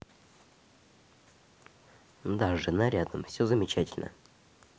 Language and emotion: Russian, neutral